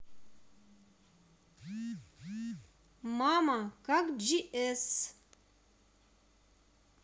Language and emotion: Russian, neutral